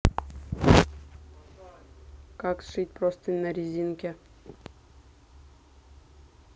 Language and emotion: Russian, neutral